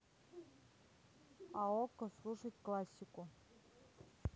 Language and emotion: Russian, neutral